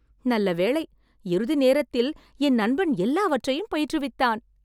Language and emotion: Tamil, happy